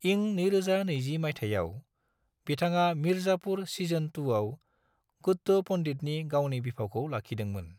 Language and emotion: Bodo, neutral